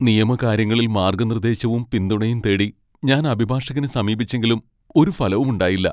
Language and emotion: Malayalam, sad